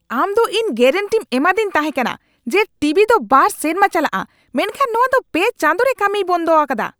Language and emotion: Santali, angry